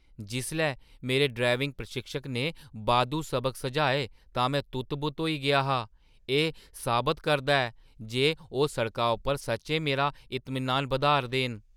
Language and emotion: Dogri, surprised